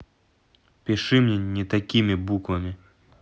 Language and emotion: Russian, angry